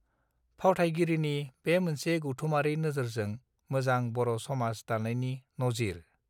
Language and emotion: Bodo, neutral